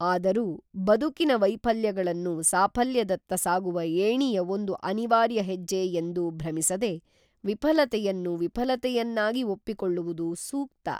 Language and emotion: Kannada, neutral